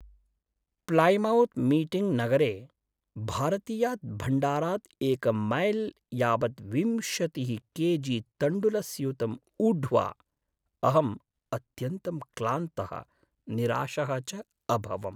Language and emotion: Sanskrit, sad